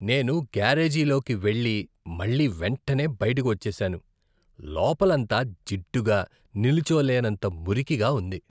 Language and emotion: Telugu, disgusted